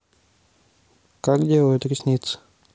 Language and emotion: Russian, neutral